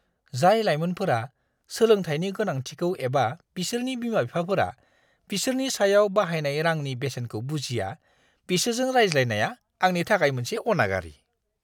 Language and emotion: Bodo, disgusted